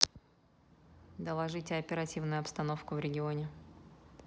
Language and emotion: Russian, neutral